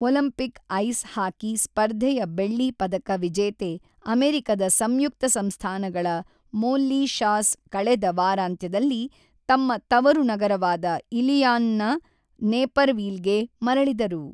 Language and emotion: Kannada, neutral